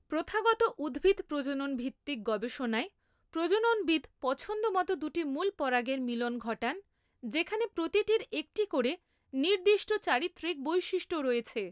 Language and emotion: Bengali, neutral